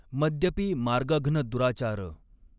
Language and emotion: Marathi, neutral